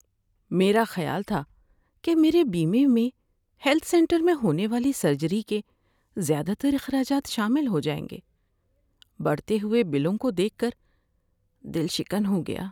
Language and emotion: Urdu, sad